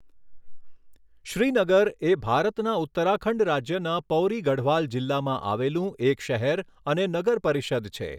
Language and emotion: Gujarati, neutral